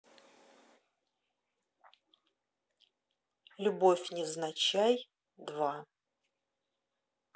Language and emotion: Russian, neutral